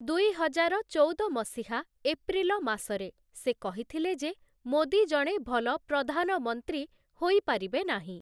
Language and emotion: Odia, neutral